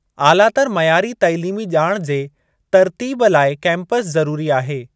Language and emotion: Sindhi, neutral